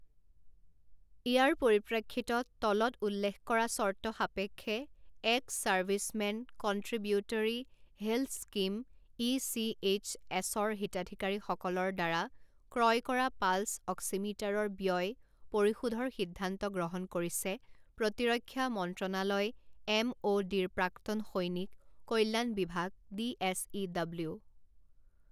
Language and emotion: Assamese, neutral